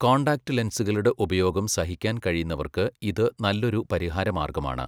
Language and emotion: Malayalam, neutral